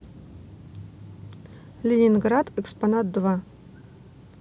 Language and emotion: Russian, neutral